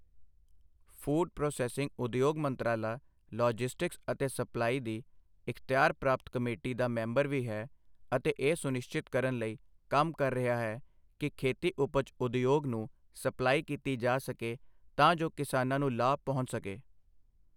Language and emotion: Punjabi, neutral